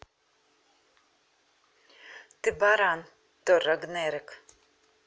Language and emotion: Russian, neutral